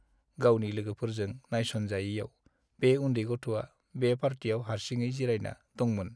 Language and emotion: Bodo, sad